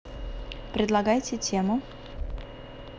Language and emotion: Russian, neutral